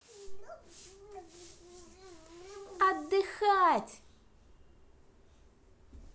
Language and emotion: Russian, positive